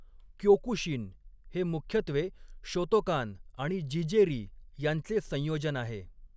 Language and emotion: Marathi, neutral